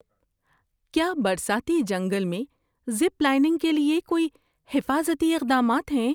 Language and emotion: Urdu, fearful